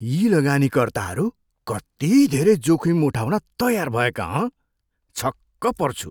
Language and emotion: Nepali, surprised